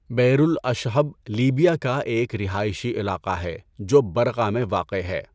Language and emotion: Urdu, neutral